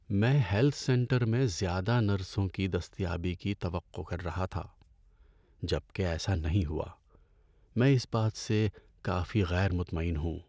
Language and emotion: Urdu, sad